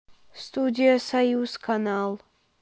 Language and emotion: Russian, neutral